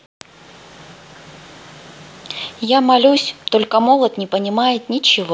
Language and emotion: Russian, neutral